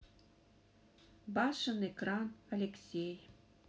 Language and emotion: Russian, neutral